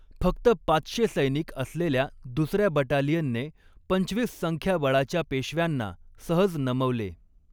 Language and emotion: Marathi, neutral